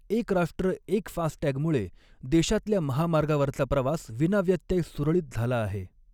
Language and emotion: Marathi, neutral